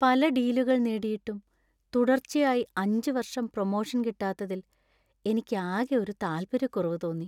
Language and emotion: Malayalam, sad